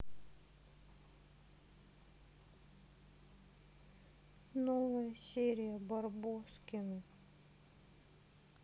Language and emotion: Russian, sad